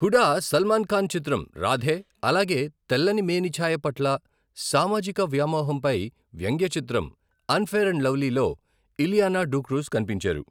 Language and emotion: Telugu, neutral